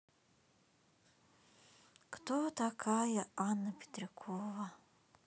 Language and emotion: Russian, sad